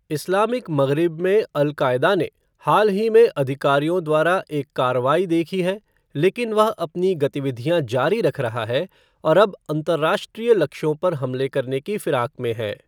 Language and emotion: Hindi, neutral